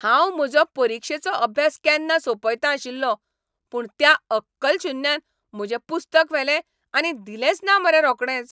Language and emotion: Goan Konkani, angry